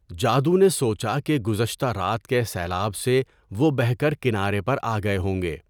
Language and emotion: Urdu, neutral